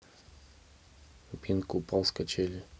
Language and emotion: Russian, neutral